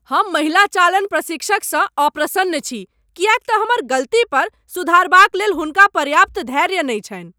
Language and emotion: Maithili, angry